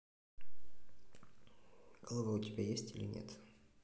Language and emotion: Russian, neutral